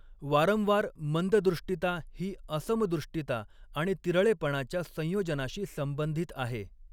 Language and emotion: Marathi, neutral